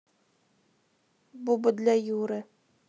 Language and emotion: Russian, neutral